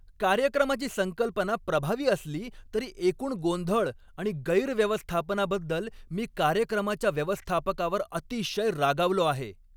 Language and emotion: Marathi, angry